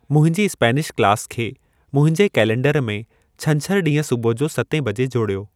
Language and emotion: Sindhi, neutral